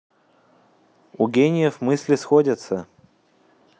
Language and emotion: Russian, neutral